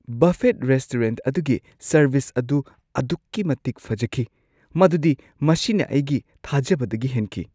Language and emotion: Manipuri, surprised